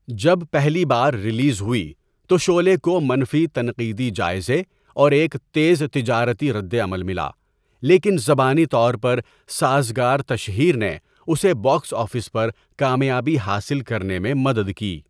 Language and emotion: Urdu, neutral